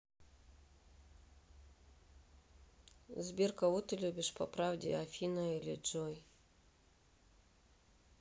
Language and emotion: Russian, neutral